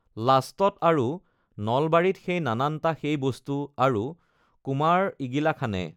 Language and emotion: Assamese, neutral